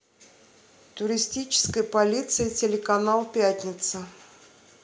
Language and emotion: Russian, neutral